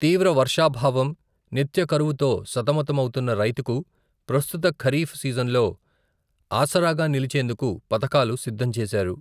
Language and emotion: Telugu, neutral